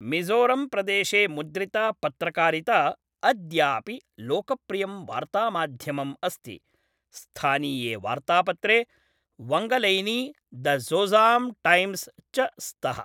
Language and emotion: Sanskrit, neutral